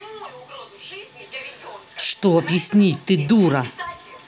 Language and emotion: Russian, angry